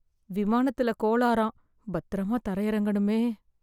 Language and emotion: Tamil, fearful